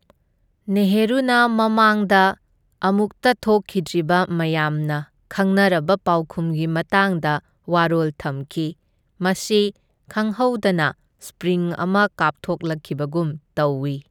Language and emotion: Manipuri, neutral